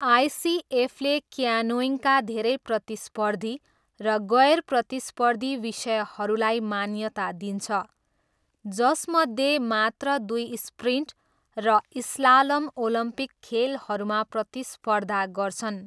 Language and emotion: Nepali, neutral